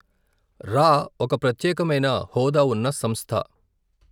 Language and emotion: Telugu, neutral